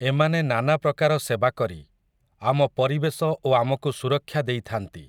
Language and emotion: Odia, neutral